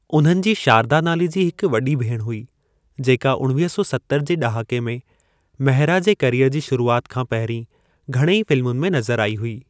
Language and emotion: Sindhi, neutral